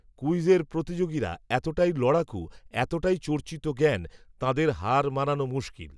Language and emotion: Bengali, neutral